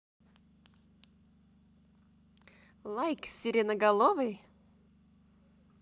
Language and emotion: Russian, positive